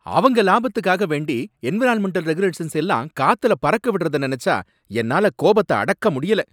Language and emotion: Tamil, angry